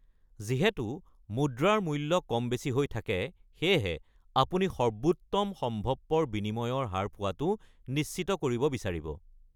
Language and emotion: Assamese, neutral